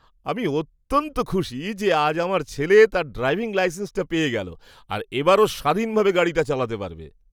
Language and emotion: Bengali, happy